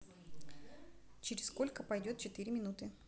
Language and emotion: Russian, neutral